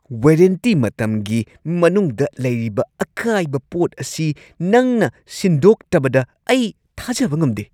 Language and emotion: Manipuri, angry